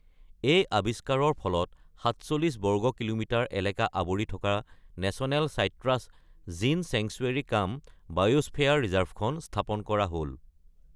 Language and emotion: Assamese, neutral